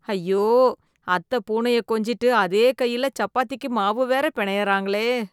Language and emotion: Tamil, disgusted